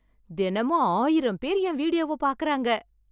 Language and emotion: Tamil, happy